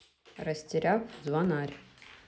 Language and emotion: Russian, neutral